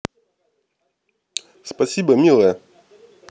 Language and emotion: Russian, positive